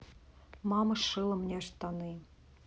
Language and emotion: Russian, neutral